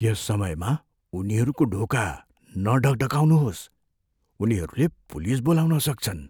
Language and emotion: Nepali, fearful